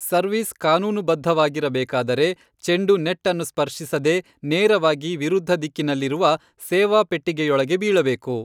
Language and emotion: Kannada, neutral